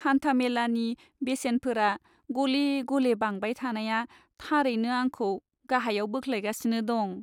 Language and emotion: Bodo, sad